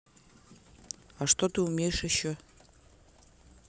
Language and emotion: Russian, neutral